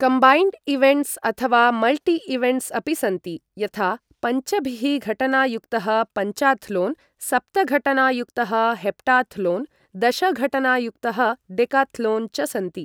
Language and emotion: Sanskrit, neutral